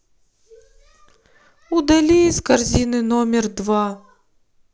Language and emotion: Russian, sad